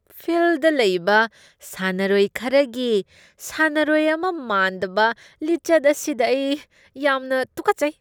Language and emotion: Manipuri, disgusted